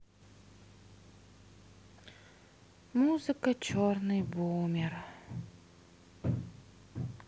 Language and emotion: Russian, sad